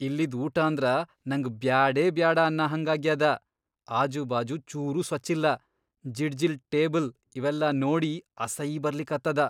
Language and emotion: Kannada, disgusted